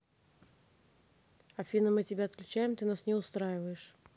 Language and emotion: Russian, neutral